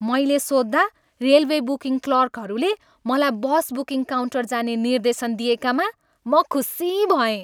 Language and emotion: Nepali, happy